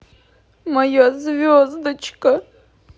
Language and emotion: Russian, sad